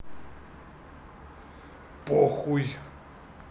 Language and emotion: Russian, neutral